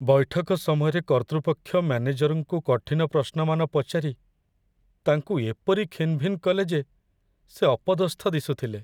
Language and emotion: Odia, sad